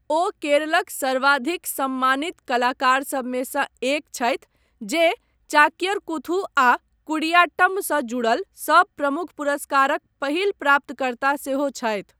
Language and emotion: Maithili, neutral